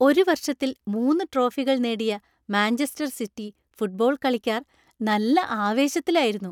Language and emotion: Malayalam, happy